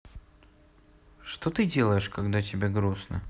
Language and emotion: Russian, sad